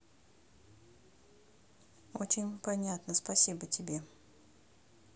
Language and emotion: Russian, neutral